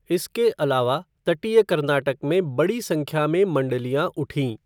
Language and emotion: Hindi, neutral